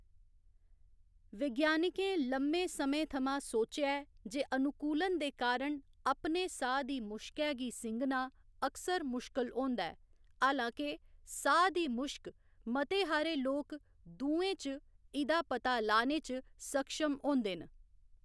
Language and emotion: Dogri, neutral